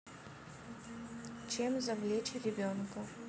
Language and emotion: Russian, neutral